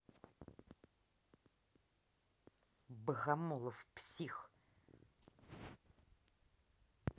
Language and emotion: Russian, angry